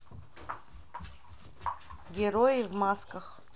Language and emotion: Russian, neutral